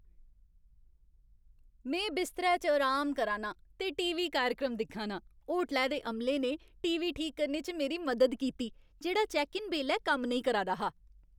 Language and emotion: Dogri, happy